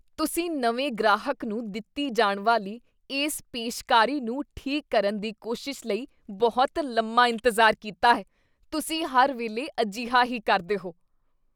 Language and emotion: Punjabi, disgusted